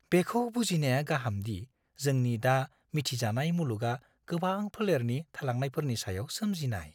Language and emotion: Bodo, fearful